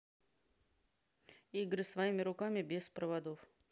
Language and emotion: Russian, neutral